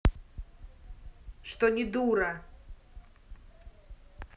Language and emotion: Russian, angry